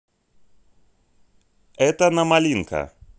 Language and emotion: Russian, positive